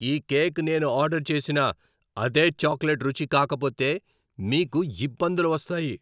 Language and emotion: Telugu, angry